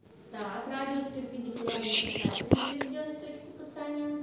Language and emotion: Russian, neutral